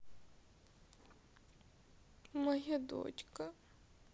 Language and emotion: Russian, sad